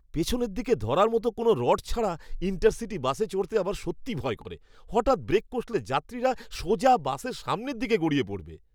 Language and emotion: Bengali, disgusted